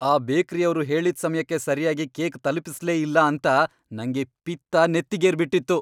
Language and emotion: Kannada, angry